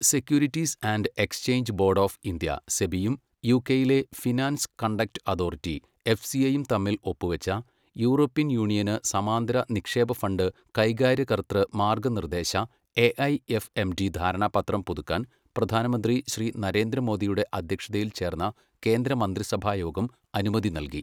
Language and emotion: Malayalam, neutral